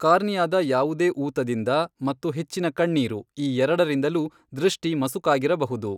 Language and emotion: Kannada, neutral